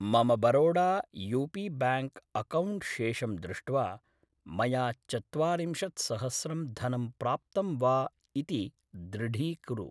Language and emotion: Sanskrit, neutral